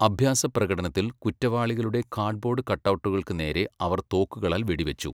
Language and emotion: Malayalam, neutral